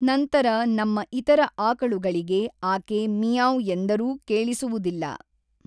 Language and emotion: Kannada, neutral